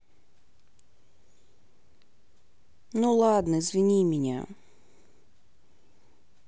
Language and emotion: Russian, sad